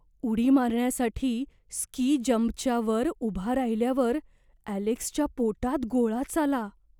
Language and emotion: Marathi, fearful